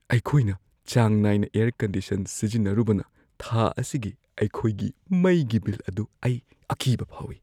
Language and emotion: Manipuri, fearful